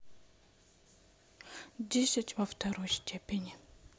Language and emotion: Russian, neutral